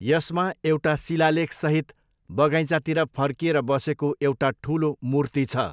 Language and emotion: Nepali, neutral